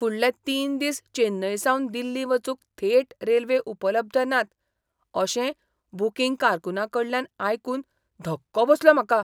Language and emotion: Goan Konkani, surprised